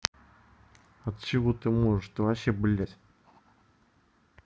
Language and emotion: Russian, angry